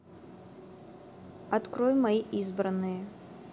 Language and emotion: Russian, neutral